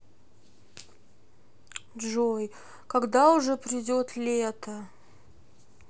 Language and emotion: Russian, sad